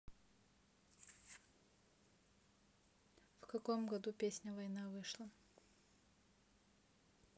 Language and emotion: Russian, neutral